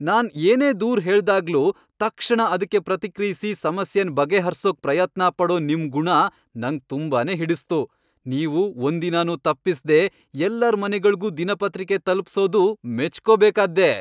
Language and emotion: Kannada, happy